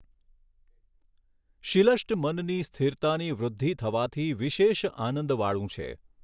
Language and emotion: Gujarati, neutral